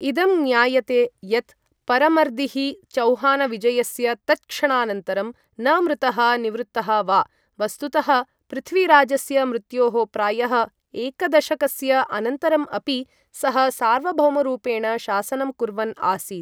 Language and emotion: Sanskrit, neutral